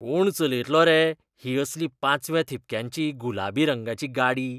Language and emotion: Goan Konkani, disgusted